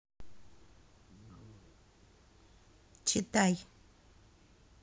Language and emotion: Russian, neutral